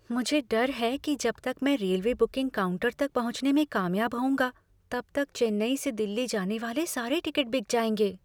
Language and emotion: Hindi, fearful